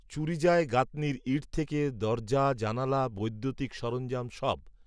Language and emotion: Bengali, neutral